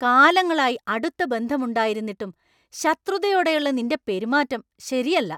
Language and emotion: Malayalam, angry